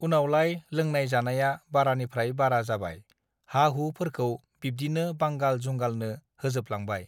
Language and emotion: Bodo, neutral